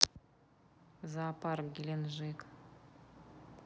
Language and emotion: Russian, neutral